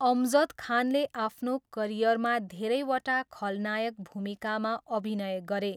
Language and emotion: Nepali, neutral